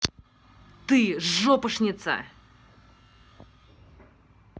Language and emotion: Russian, angry